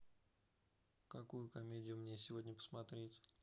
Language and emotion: Russian, neutral